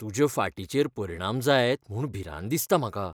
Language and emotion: Goan Konkani, fearful